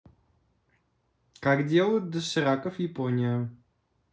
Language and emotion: Russian, neutral